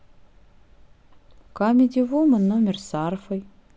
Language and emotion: Russian, neutral